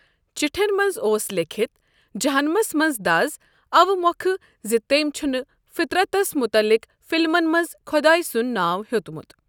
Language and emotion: Kashmiri, neutral